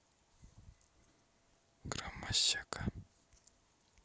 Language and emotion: Russian, neutral